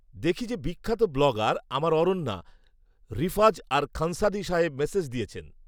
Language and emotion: Bengali, neutral